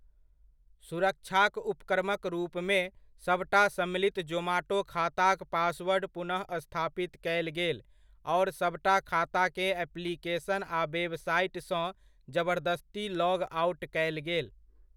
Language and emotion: Maithili, neutral